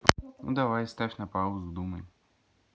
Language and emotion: Russian, neutral